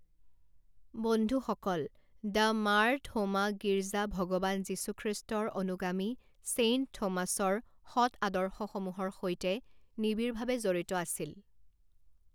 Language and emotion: Assamese, neutral